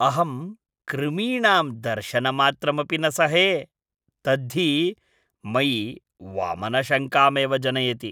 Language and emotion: Sanskrit, disgusted